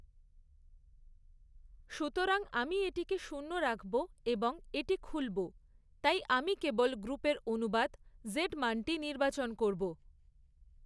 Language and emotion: Bengali, neutral